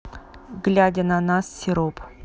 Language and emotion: Russian, neutral